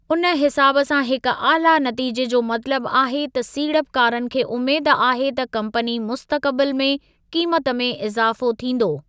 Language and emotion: Sindhi, neutral